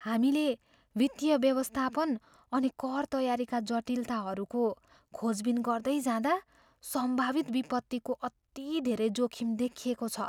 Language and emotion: Nepali, fearful